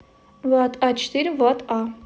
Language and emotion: Russian, neutral